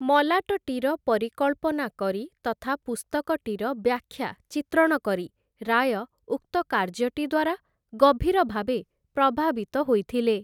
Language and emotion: Odia, neutral